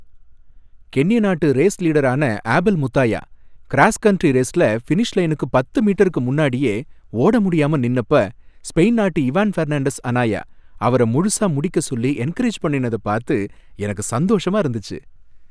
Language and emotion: Tamil, happy